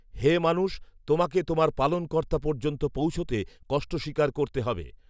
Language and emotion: Bengali, neutral